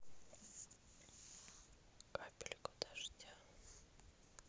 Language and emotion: Russian, neutral